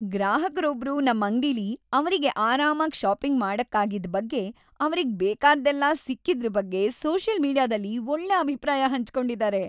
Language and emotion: Kannada, happy